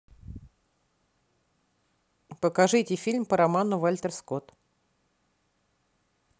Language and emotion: Russian, neutral